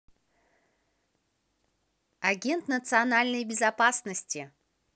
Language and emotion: Russian, positive